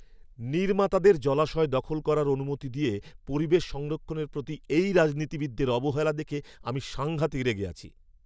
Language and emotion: Bengali, angry